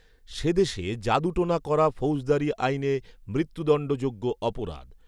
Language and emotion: Bengali, neutral